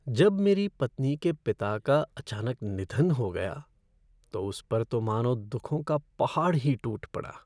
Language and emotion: Hindi, sad